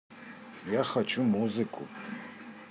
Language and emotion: Russian, neutral